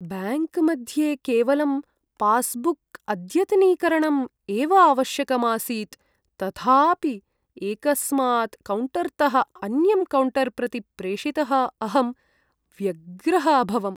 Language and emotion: Sanskrit, sad